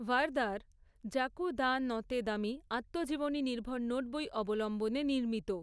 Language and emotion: Bengali, neutral